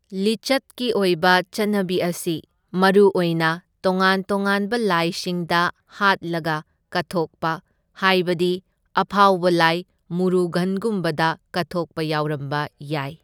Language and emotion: Manipuri, neutral